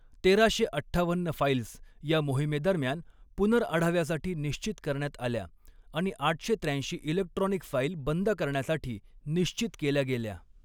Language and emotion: Marathi, neutral